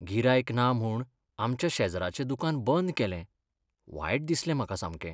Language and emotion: Goan Konkani, sad